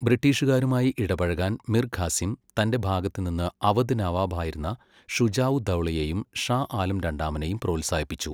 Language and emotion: Malayalam, neutral